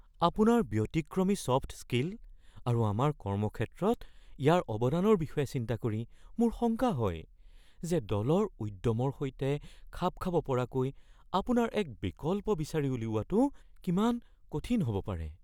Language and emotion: Assamese, fearful